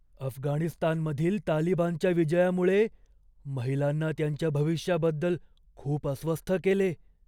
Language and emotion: Marathi, fearful